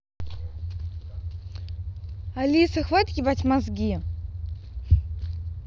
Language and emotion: Russian, angry